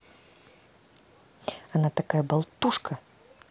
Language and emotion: Russian, angry